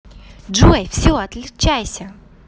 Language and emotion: Russian, positive